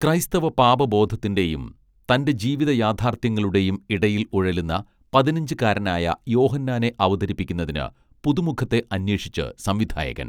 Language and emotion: Malayalam, neutral